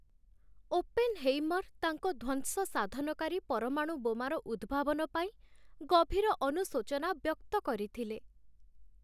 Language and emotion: Odia, sad